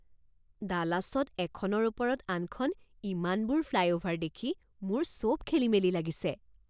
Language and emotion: Assamese, surprised